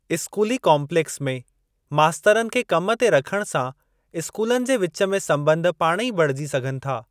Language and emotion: Sindhi, neutral